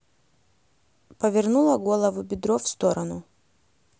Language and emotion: Russian, neutral